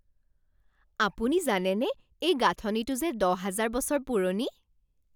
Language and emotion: Assamese, surprised